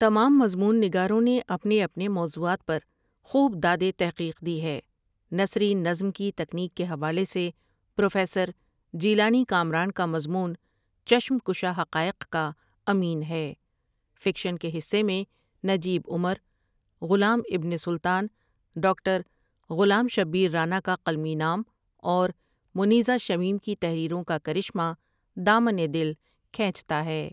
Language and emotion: Urdu, neutral